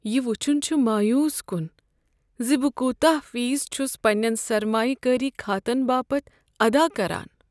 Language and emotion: Kashmiri, sad